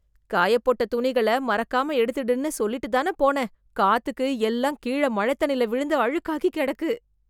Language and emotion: Tamil, disgusted